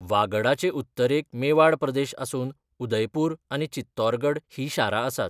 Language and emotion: Goan Konkani, neutral